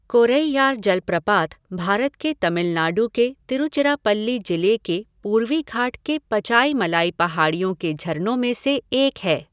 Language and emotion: Hindi, neutral